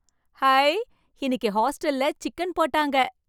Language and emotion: Tamil, surprised